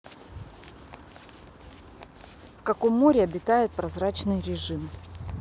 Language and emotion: Russian, neutral